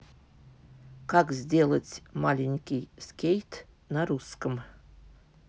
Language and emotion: Russian, neutral